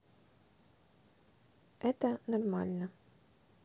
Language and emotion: Russian, neutral